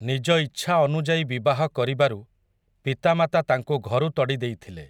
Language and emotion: Odia, neutral